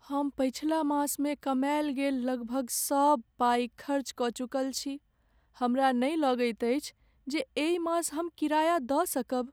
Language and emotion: Maithili, sad